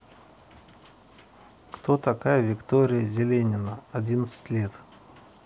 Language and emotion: Russian, neutral